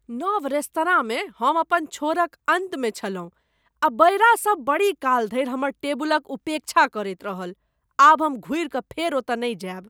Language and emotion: Maithili, disgusted